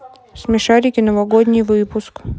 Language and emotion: Russian, neutral